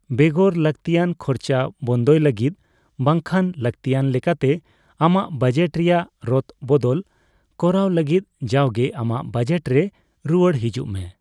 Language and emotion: Santali, neutral